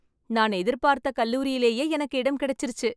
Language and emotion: Tamil, happy